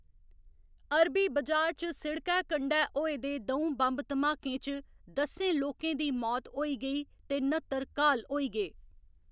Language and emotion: Dogri, neutral